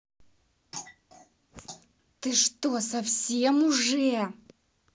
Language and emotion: Russian, angry